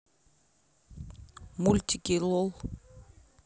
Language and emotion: Russian, neutral